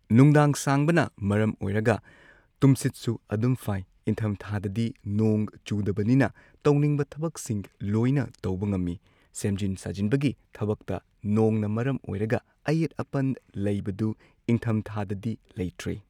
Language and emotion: Manipuri, neutral